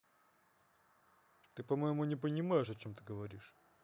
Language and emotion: Russian, angry